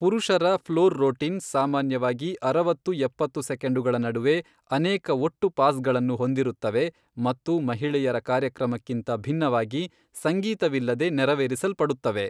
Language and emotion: Kannada, neutral